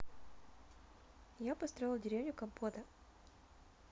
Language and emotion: Russian, neutral